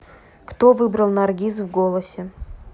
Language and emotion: Russian, neutral